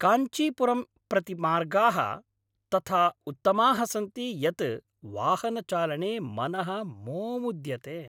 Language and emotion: Sanskrit, happy